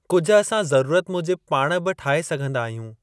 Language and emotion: Sindhi, neutral